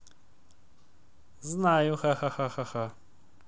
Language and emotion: Russian, neutral